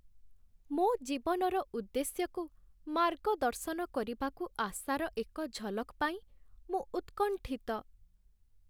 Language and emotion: Odia, sad